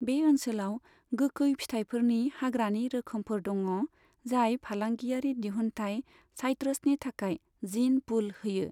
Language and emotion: Bodo, neutral